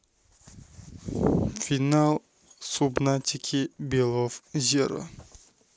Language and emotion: Russian, neutral